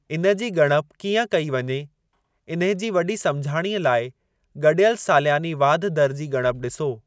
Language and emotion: Sindhi, neutral